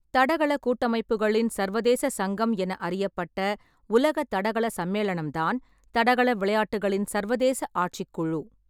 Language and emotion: Tamil, neutral